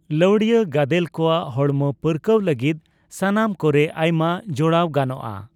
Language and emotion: Santali, neutral